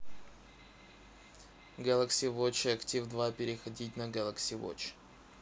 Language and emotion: Russian, neutral